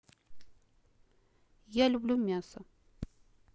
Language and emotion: Russian, neutral